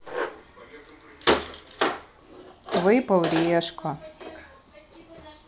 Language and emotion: Russian, neutral